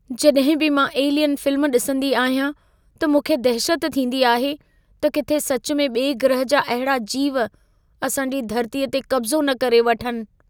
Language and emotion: Sindhi, fearful